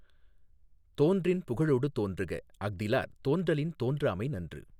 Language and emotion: Tamil, neutral